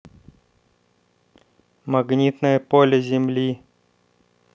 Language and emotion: Russian, neutral